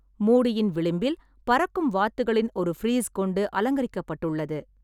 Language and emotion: Tamil, neutral